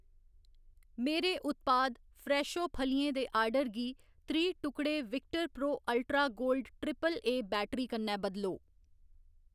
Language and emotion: Dogri, neutral